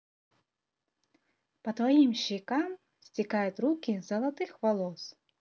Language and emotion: Russian, positive